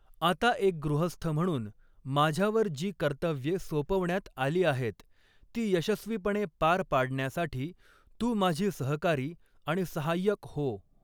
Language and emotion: Marathi, neutral